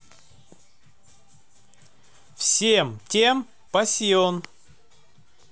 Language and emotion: Russian, positive